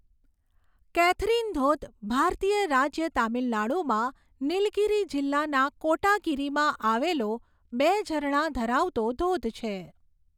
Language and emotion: Gujarati, neutral